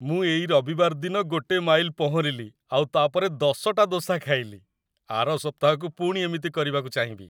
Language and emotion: Odia, happy